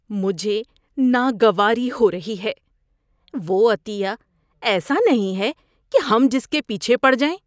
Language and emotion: Urdu, disgusted